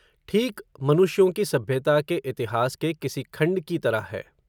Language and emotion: Hindi, neutral